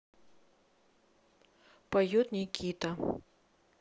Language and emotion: Russian, neutral